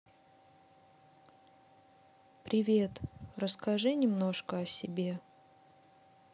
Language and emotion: Russian, neutral